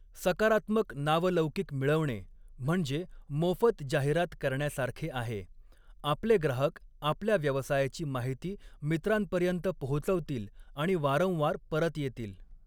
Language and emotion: Marathi, neutral